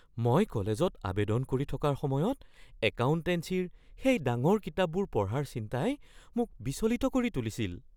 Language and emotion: Assamese, fearful